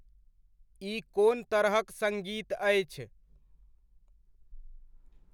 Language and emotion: Maithili, neutral